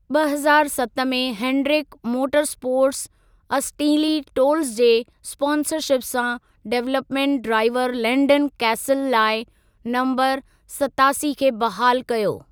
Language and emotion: Sindhi, neutral